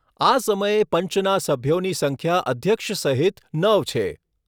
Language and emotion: Gujarati, neutral